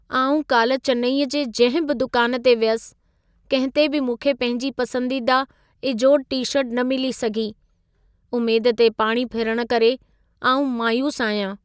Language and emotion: Sindhi, sad